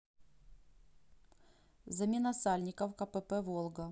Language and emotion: Russian, neutral